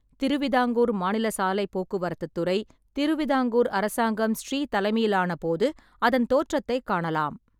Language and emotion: Tamil, neutral